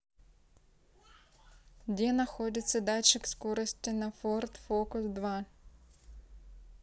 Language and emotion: Russian, neutral